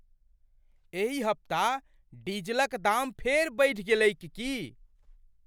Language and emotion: Maithili, surprised